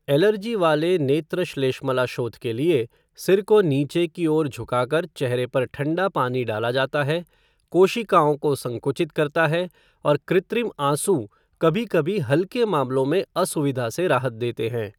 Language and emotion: Hindi, neutral